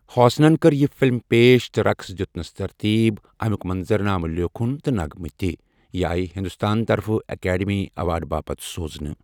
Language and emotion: Kashmiri, neutral